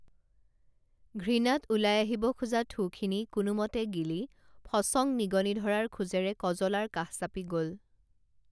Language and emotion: Assamese, neutral